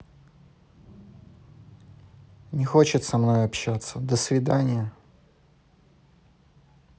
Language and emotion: Russian, neutral